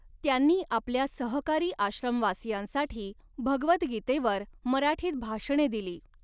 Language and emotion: Marathi, neutral